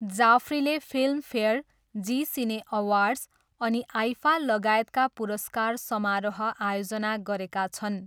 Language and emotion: Nepali, neutral